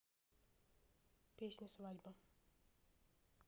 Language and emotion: Russian, neutral